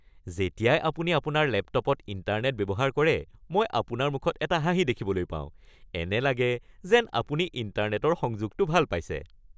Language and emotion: Assamese, happy